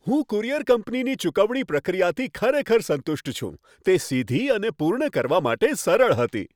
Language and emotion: Gujarati, happy